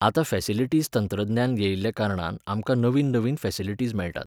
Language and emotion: Goan Konkani, neutral